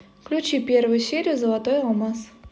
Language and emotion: Russian, neutral